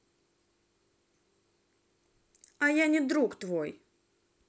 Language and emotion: Russian, angry